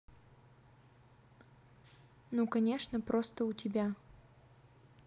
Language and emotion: Russian, neutral